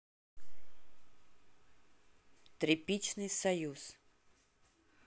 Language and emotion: Russian, neutral